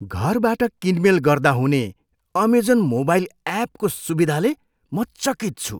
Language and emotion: Nepali, surprised